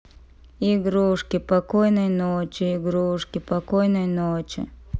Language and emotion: Russian, sad